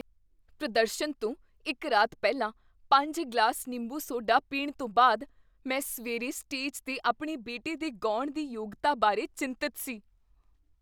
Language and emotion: Punjabi, fearful